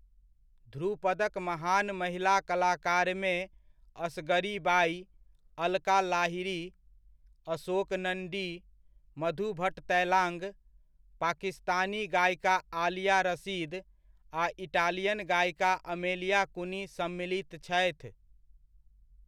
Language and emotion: Maithili, neutral